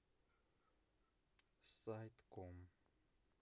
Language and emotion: Russian, neutral